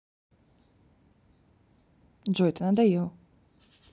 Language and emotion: Russian, neutral